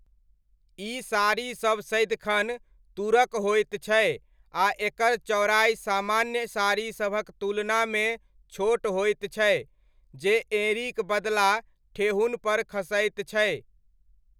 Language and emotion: Maithili, neutral